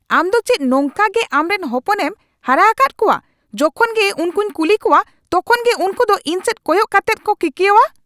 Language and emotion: Santali, angry